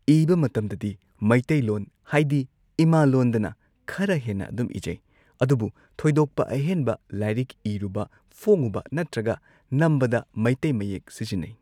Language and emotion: Manipuri, neutral